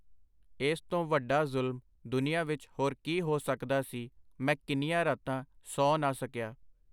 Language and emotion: Punjabi, neutral